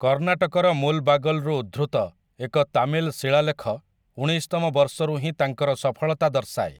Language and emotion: Odia, neutral